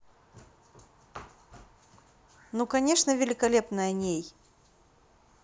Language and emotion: Russian, positive